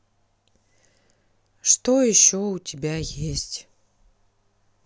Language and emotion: Russian, sad